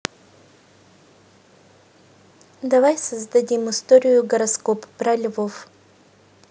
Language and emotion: Russian, neutral